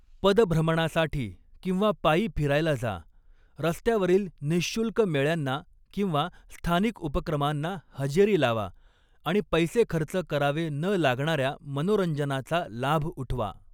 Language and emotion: Marathi, neutral